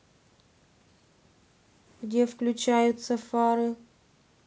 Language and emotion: Russian, neutral